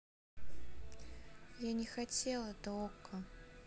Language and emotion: Russian, sad